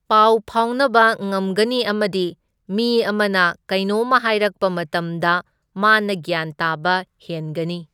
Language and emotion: Manipuri, neutral